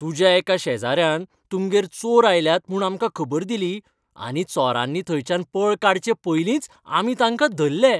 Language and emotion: Goan Konkani, happy